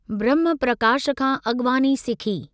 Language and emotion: Sindhi, neutral